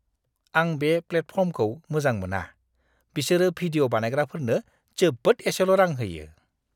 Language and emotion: Bodo, disgusted